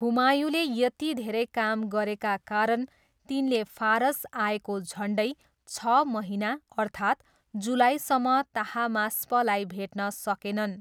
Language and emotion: Nepali, neutral